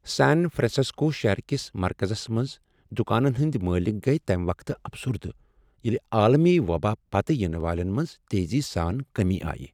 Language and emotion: Kashmiri, sad